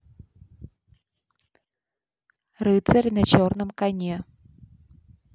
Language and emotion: Russian, neutral